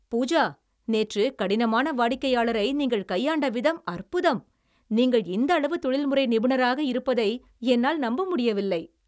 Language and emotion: Tamil, happy